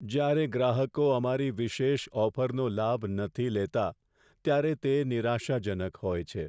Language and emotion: Gujarati, sad